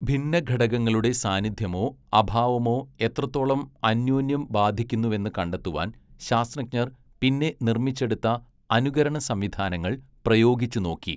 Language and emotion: Malayalam, neutral